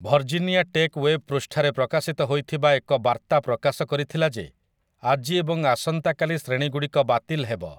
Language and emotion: Odia, neutral